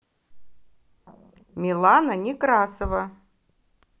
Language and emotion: Russian, positive